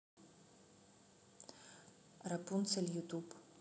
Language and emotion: Russian, neutral